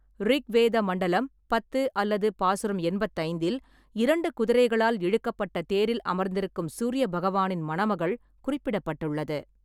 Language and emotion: Tamil, neutral